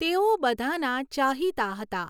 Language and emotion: Gujarati, neutral